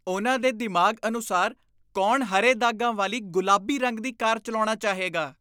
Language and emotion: Punjabi, disgusted